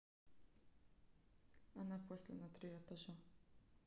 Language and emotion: Russian, neutral